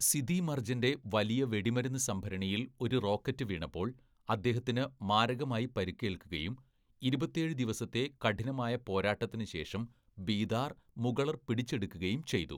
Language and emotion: Malayalam, neutral